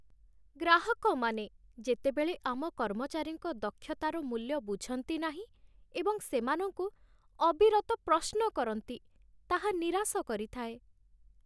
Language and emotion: Odia, sad